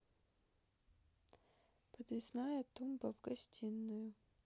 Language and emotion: Russian, neutral